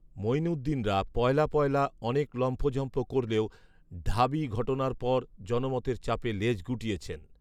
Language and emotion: Bengali, neutral